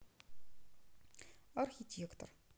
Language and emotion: Russian, neutral